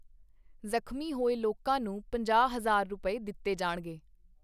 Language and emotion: Punjabi, neutral